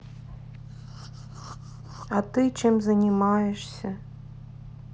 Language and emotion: Russian, sad